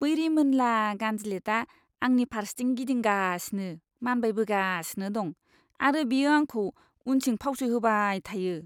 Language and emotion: Bodo, disgusted